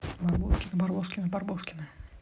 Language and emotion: Russian, neutral